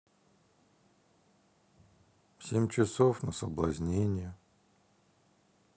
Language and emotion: Russian, sad